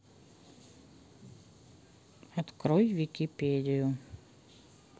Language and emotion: Russian, neutral